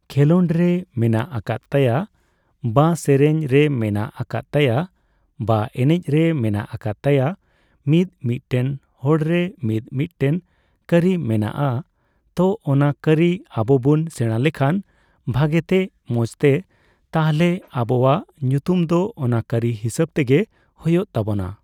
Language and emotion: Santali, neutral